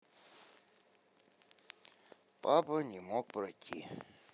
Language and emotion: Russian, sad